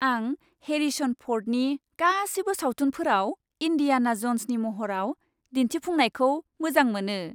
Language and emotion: Bodo, happy